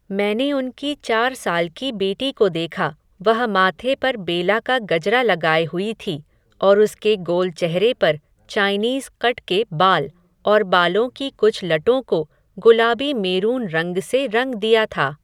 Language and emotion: Hindi, neutral